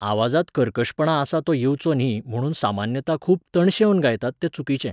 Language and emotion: Goan Konkani, neutral